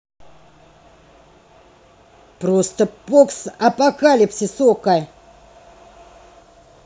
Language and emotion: Russian, angry